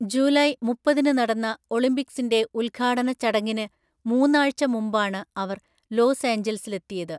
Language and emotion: Malayalam, neutral